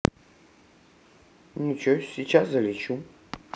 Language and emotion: Russian, neutral